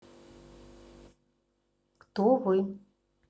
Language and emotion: Russian, neutral